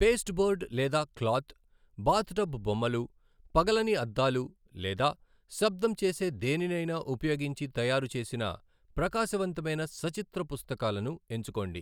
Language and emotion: Telugu, neutral